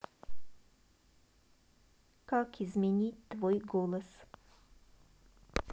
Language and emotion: Russian, neutral